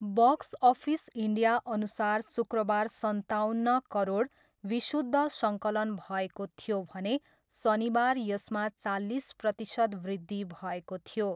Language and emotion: Nepali, neutral